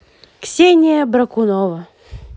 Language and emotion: Russian, positive